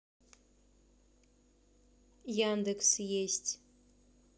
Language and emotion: Russian, neutral